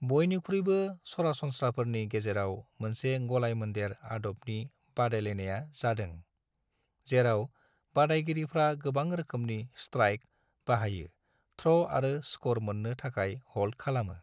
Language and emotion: Bodo, neutral